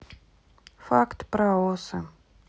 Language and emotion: Russian, sad